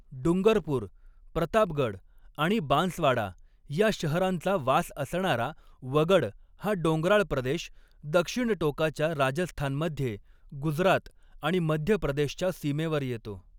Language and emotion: Marathi, neutral